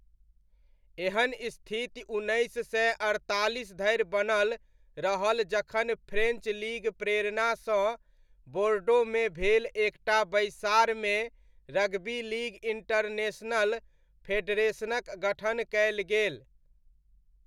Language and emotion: Maithili, neutral